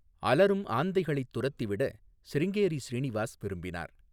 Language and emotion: Tamil, neutral